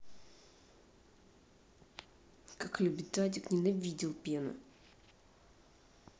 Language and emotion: Russian, angry